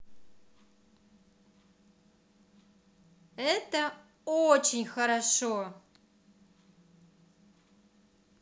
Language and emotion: Russian, positive